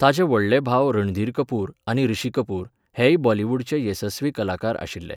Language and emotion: Goan Konkani, neutral